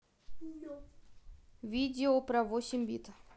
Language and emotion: Russian, neutral